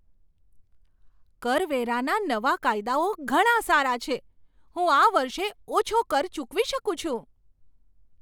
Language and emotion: Gujarati, surprised